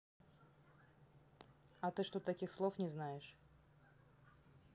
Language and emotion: Russian, neutral